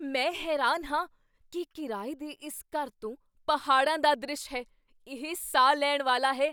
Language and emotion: Punjabi, surprised